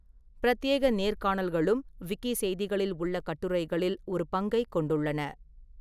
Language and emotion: Tamil, neutral